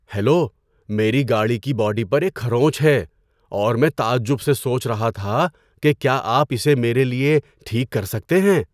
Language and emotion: Urdu, surprised